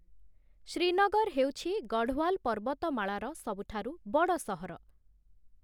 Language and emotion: Odia, neutral